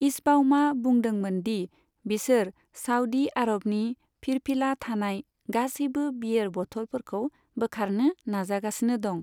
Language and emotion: Bodo, neutral